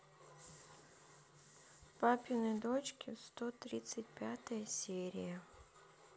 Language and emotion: Russian, sad